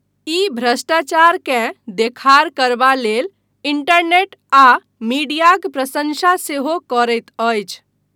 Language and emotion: Maithili, neutral